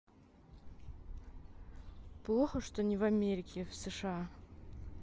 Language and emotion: Russian, sad